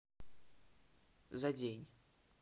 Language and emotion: Russian, neutral